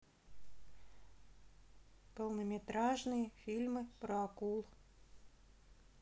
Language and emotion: Russian, neutral